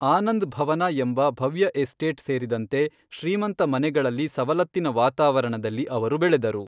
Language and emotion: Kannada, neutral